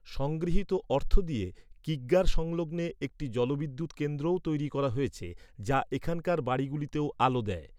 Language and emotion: Bengali, neutral